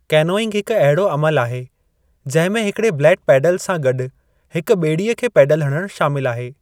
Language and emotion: Sindhi, neutral